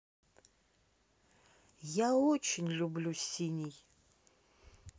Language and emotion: Russian, neutral